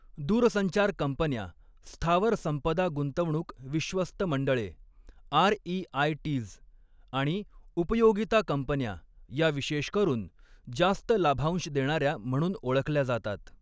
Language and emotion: Marathi, neutral